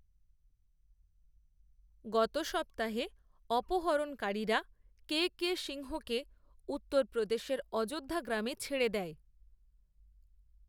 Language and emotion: Bengali, neutral